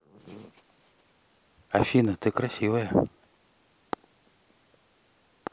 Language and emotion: Russian, neutral